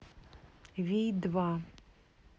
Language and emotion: Russian, neutral